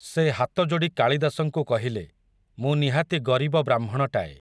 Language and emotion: Odia, neutral